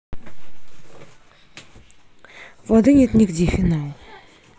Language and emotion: Russian, neutral